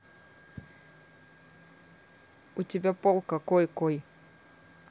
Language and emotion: Russian, neutral